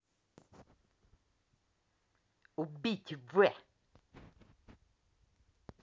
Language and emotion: Russian, angry